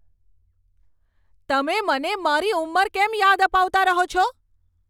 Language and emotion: Gujarati, angry